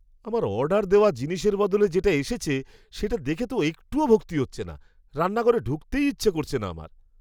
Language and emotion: Bengali, disgusted